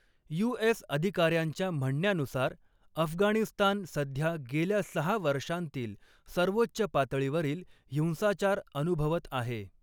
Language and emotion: Marathi, neutral